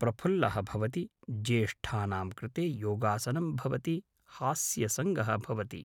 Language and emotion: Sanskrit, neutral